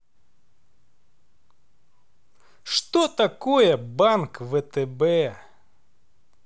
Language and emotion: Russian, neutral